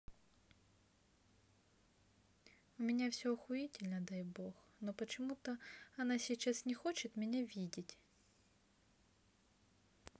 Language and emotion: Russian, neutral